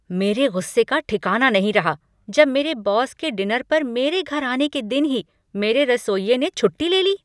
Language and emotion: Hindi, angry